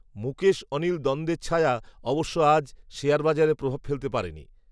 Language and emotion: Bengali, neutral